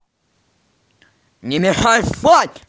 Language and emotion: Russian, angry